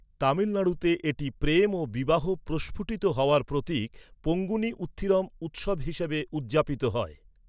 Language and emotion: Bengali, neutral